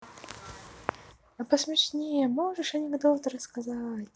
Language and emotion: Russian, positive